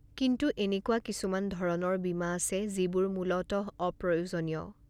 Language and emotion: Assamese, neutral